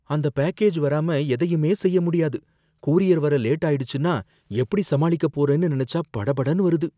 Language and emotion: Tamil, fearful